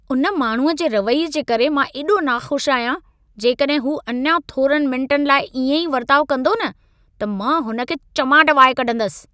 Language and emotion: Sindhi, angry